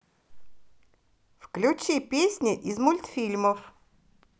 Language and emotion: Russian, positive